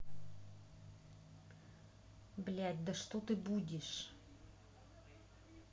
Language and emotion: Russian, angry